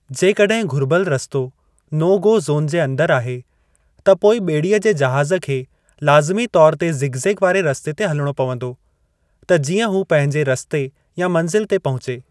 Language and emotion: Sindhi, neutral